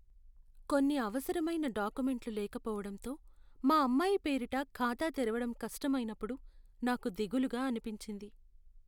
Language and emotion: Telugu, sad